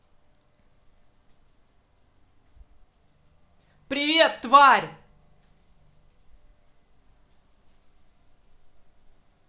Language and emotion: Russian, angry